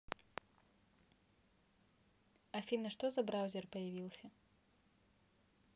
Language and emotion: Russian, neutral